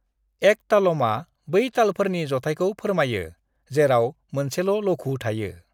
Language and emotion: Bodo, neutral